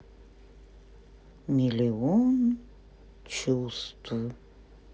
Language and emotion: Russian, sad